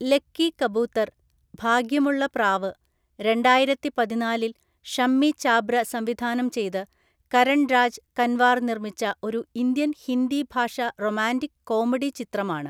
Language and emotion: Malayalam, neutral